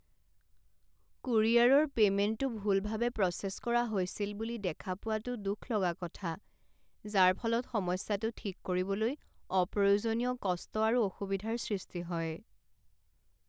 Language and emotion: Assamese, sad